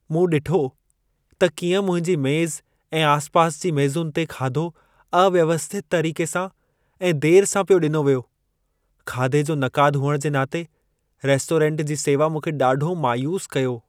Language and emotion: Sindhi, sad